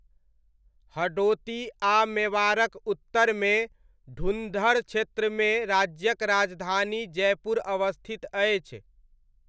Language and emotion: Maithili, neutral